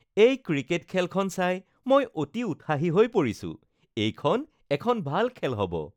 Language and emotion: Assamese, happy